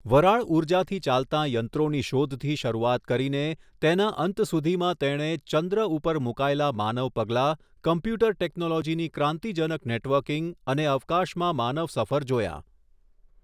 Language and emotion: Gujarati, neutral